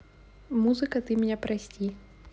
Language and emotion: Russian, neutral